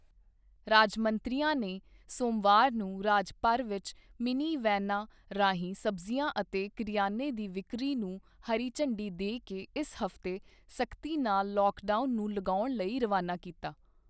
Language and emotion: Punjabi, neutral